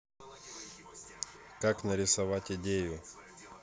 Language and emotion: Russian, neutral